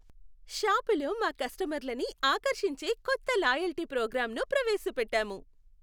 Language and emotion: Telugu, happy